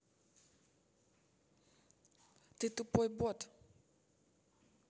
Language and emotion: Russian, neutral